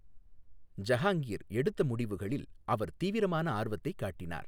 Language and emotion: Tamil, neutral